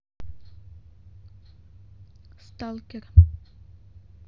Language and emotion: Russian, neutral